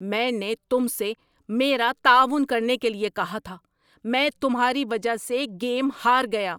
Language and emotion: Urdu, angry